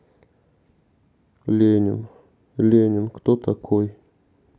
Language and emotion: Russian, neutral